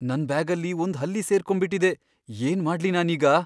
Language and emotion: Kannada, fearful